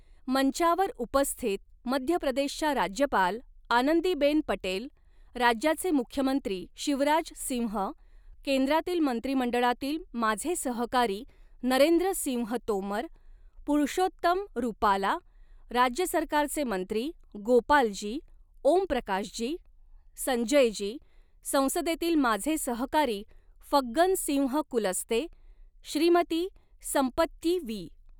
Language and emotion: Marathi, neutral